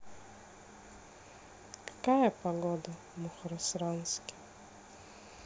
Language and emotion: Russian, sad